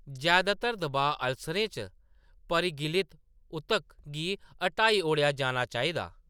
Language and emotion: Dogri, neutral